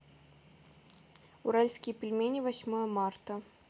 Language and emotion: Russian, neutral